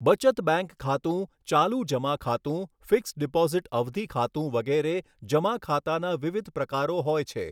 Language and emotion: Gujarati, neutral